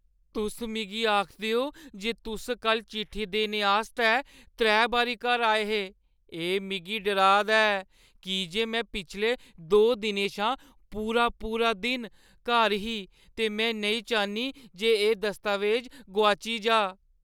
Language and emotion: Dogri, fearful